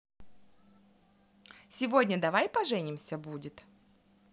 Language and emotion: Russian, positive